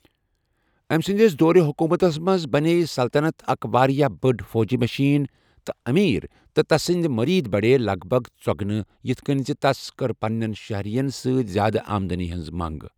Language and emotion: Kashmiri, neutral